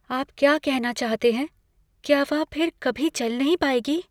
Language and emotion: Hindi, fearful